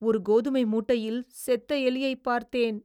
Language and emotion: Tamil, disgusted